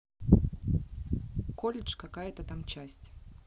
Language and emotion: Russian, neutral